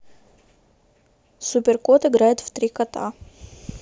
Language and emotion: Russian, neutral